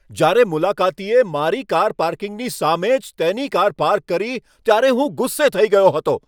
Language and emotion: Gujarati, angry